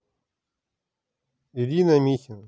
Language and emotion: Russian, neutral